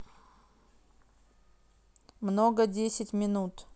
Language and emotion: Russian, neutral